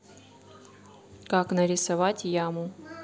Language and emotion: Russian, neutral